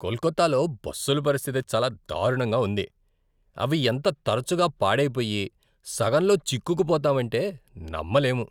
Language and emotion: Telugu, disgusted